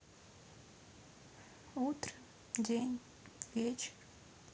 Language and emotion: Russian, sad